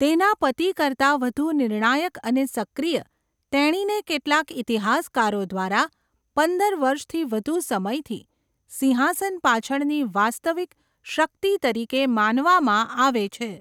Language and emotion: Gujarati, neutral